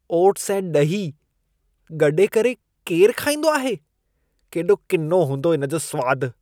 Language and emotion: Sindhi, disgusted